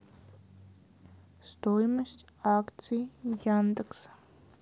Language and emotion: Russian, neutral